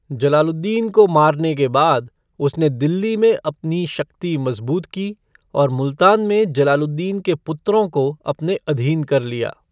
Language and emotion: Hindi, neutral